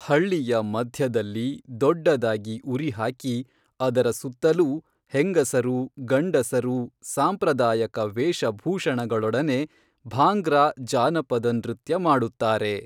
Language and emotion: Kannada, neutral